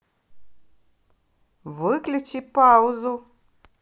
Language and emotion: Russian, positive